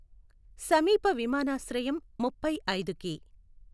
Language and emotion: Telugu, neutral